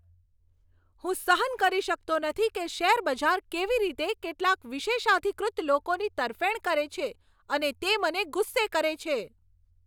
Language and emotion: Gujarati, angry